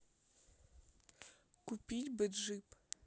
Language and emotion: Russian, neutral